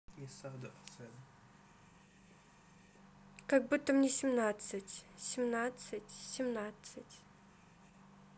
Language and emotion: Russian, neutral